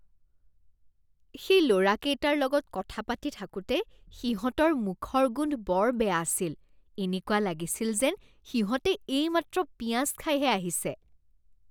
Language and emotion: Assamese, disgusted